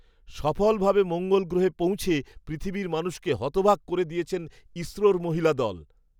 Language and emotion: Bengali, surprised